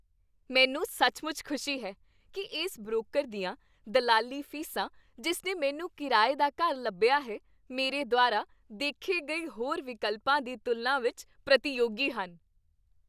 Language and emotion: Punjabi, happy